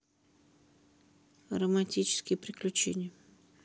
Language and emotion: Russian, neutral